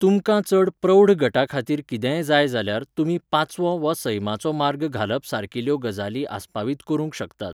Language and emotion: Goan Konkani, neutral